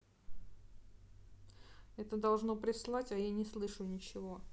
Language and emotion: Russian, sad